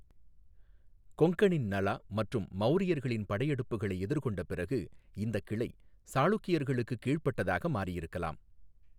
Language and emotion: Tamil, neutral